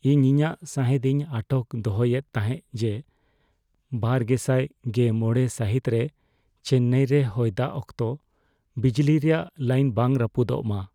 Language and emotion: Santali, fearful